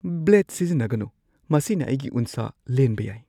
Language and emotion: Manipuri, fearful